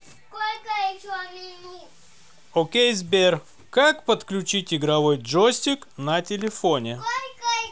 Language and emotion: Russian, positive